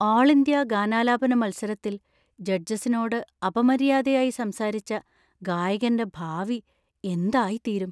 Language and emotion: Malayalam, fearful